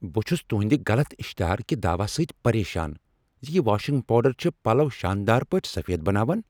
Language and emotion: Kashmiri, angry